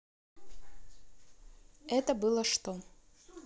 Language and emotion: Russian, neutral